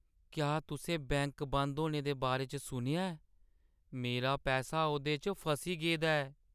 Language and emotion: Dogri, sad